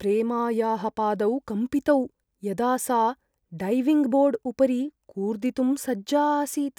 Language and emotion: Sanskrit, fearful